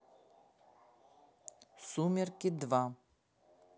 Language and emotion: Russian, neutral